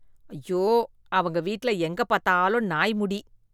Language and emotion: Tamil, disgusted